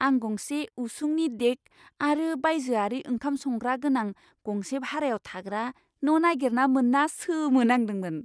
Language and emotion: Bodo, surprised